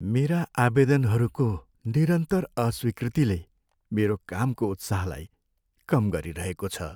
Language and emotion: Nepali, sad